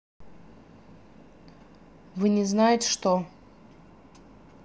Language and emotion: Russian, neutral